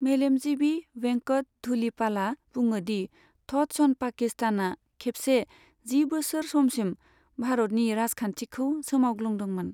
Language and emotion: Bodo, neutral